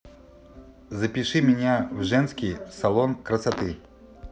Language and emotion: Russian, neutral